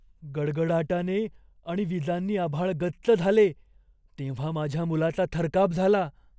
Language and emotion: Marathi, fearful